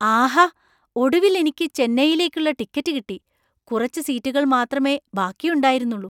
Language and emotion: Malayalam, surprised